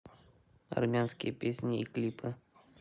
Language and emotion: Russian, neutral